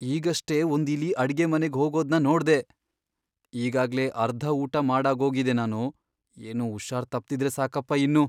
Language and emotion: Kannada, fearful